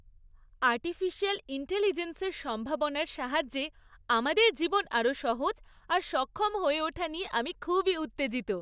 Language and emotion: Bengali, happy